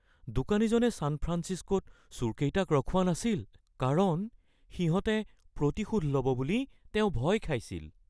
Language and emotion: Assamese, fearful